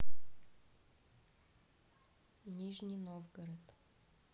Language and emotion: Russian, neutral